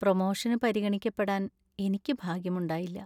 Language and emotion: Malayalam, sad